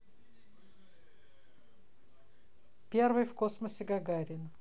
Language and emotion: Russian, neutral